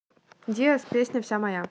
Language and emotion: Russian, neutral